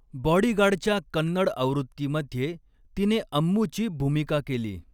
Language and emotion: Marathi, neutral